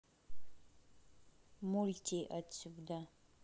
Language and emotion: Russian, neutral